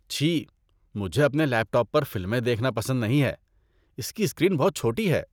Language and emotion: Urdu, disgusted